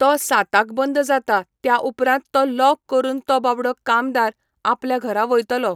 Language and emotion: Goan Konkani, neutral